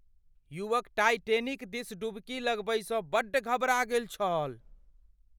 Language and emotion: Maithili, fearful